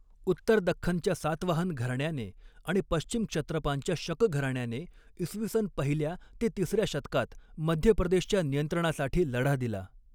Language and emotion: Marathi, neutral